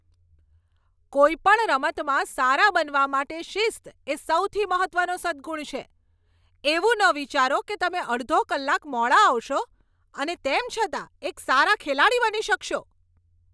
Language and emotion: Gujarati, angry